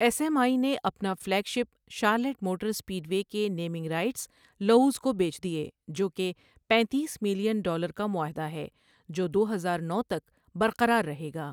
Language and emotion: Urdu, neutral